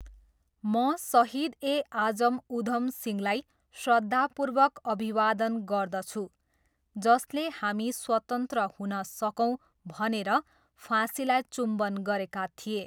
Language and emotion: Nepali, neutral